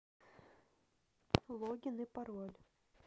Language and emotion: Russian, neutral